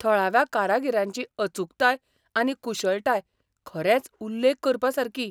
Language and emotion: Goan Konkani, surprised